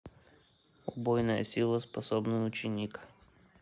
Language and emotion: Russian, neutral